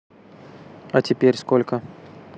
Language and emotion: Russian, neutral